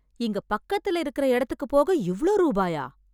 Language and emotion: Tamil, surprised